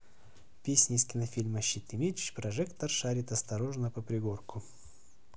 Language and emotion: Russian, neutral